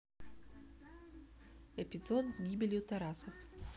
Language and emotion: Russian, neutral